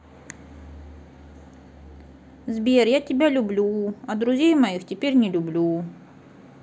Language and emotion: Russian, sad